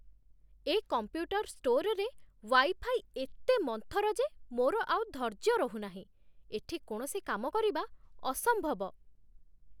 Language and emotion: Odia, disgusted